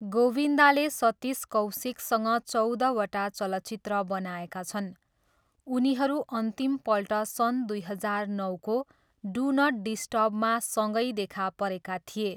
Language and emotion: Nepali, neutral